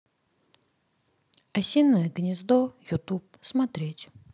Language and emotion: Russian, sad